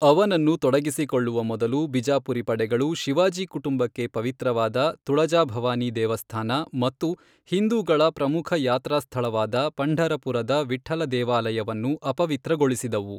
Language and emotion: Kannada, neutral